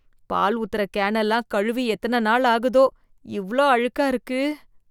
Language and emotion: Tamil, disgusted